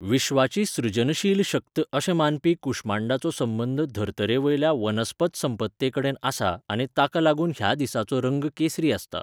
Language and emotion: Goan Konkani, neutral